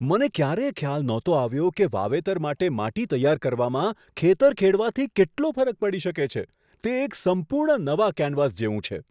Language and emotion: Gujarati, surprised